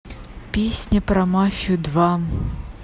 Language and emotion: Russian, neutral